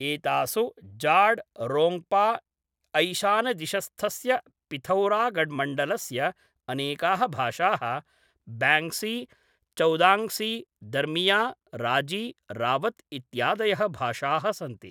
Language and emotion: Sanskrit, neutral